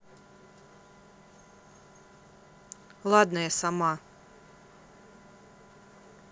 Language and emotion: Russian, angry